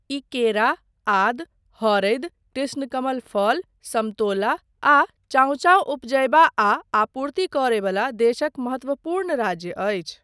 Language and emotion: Maithili, neutral